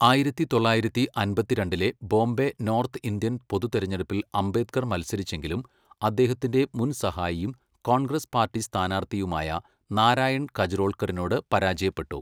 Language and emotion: Malayalam, neutral